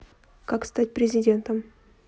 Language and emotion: Russian, neutral